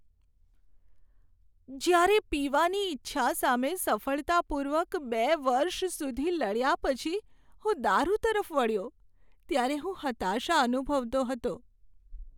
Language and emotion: Gujarati, sad